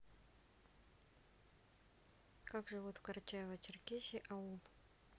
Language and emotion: Russian, neutral